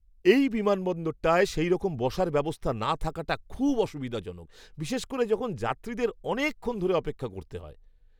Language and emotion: Bengali, disgusted